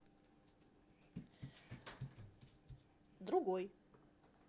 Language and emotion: Russian, neutral